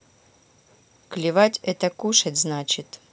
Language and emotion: Russian, neutral